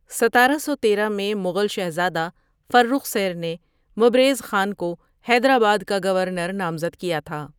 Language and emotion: Urdu, neutral